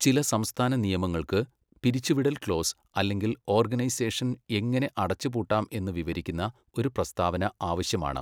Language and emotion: Malayalam, neutral